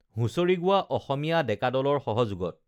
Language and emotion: Assamese, neutral